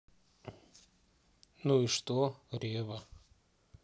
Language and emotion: Russian, neutral